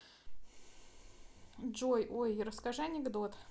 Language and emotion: Russian, neutral